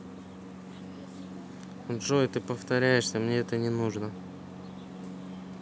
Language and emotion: Russian, neutral